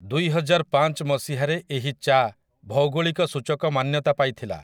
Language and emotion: Odia, neutral